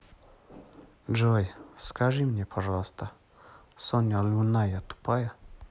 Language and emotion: Russian, neutral